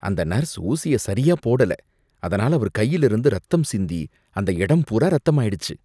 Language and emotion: Tamil, disgusted